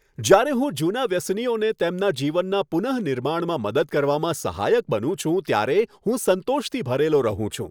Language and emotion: Gujarati, happy